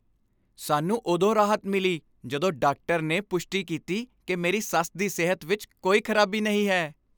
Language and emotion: Punjabi, happy